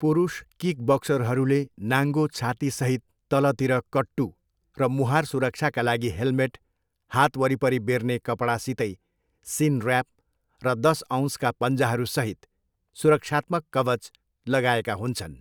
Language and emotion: Nepali, neutral